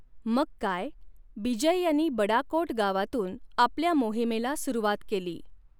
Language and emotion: Marathi, neutral